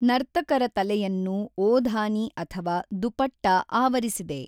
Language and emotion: Kannada, neutral